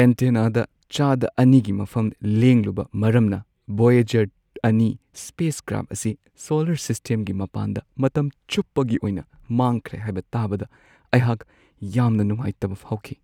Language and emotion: Manipuri, sad